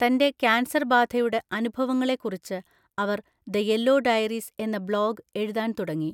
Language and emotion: Malayalam, neutral